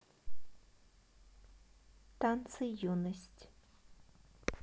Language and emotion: Russian, neutral